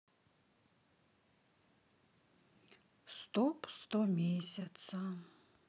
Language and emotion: Russian, sad